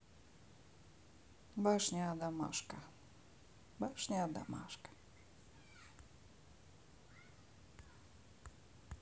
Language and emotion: Russian, neutral